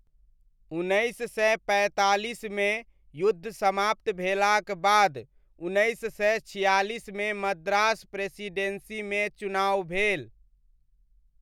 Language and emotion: Maithili, neutral